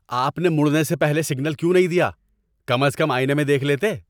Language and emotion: Urdu, angry